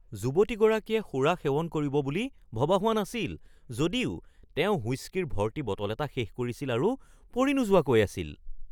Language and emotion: Assamese, surprised